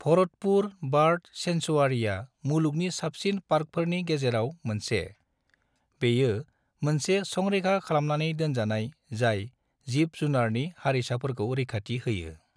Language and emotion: Bodo, neutral